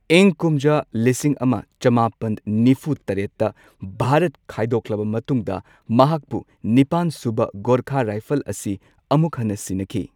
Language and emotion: Manipuri, neutral